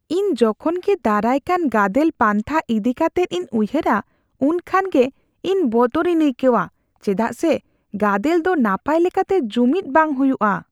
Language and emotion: Santali, fearful